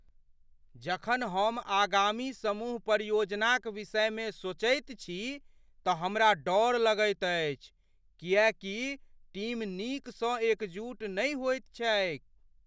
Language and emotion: Maithili, fearful